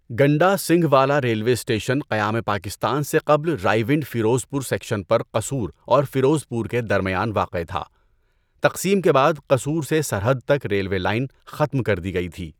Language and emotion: Urdu, neutral